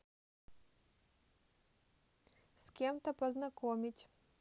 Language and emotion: Russian, neutral